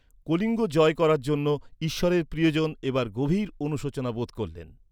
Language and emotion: Bengali, neutral